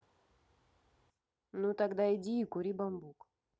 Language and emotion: Russian, neutral